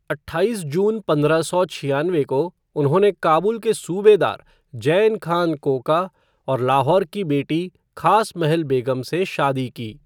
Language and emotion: Hindi, neutral